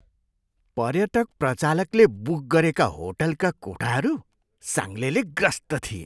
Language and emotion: Nepali, disgusted